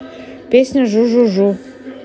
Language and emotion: Russian, neutral